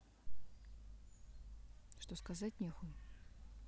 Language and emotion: Russian, angry